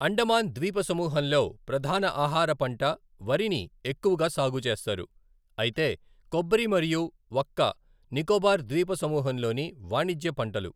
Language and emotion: Telugu, neutral